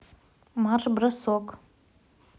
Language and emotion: Russian, neutral